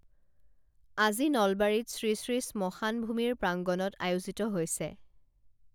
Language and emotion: Assamese, neutral